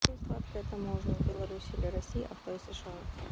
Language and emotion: Russian, neutral